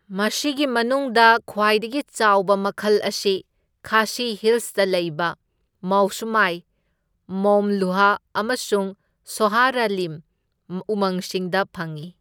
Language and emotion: Manipuri, neutral